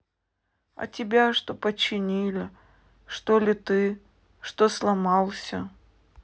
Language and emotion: Russian, sad